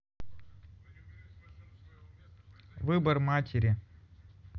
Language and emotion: Russian, neutral